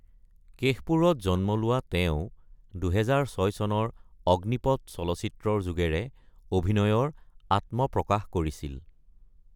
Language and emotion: Assamese, neutral